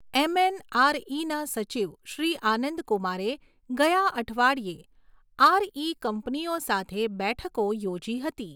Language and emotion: Gujarati, neutral